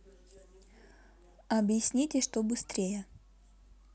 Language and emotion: Russian, neutral